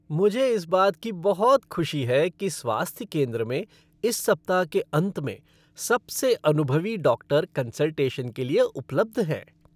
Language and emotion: Hindi, happy